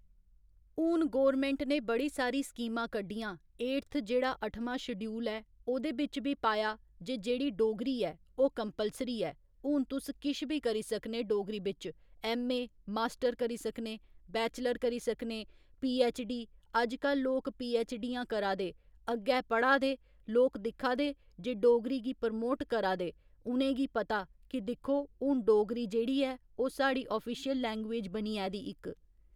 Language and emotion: Dogri, neutral